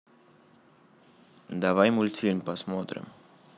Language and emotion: Russian, neutral